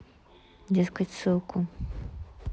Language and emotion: Russian, neutral